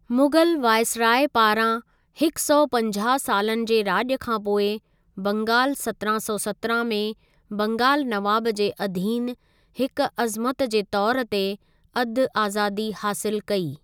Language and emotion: Sindhi, neutral